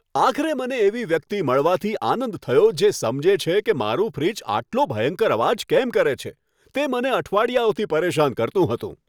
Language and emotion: Gujarati, happy